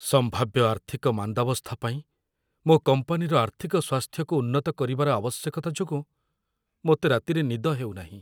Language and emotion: Odia, fearful